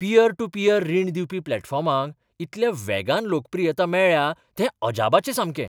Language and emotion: Goan Konkani, surprised